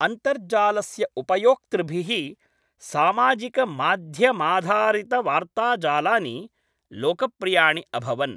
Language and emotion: Sanskrit, neutral